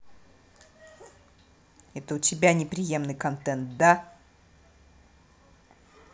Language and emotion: Russian, angry